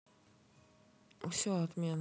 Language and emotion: Russian, neutral